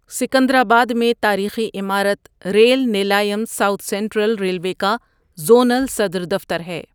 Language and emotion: Urdu, neutral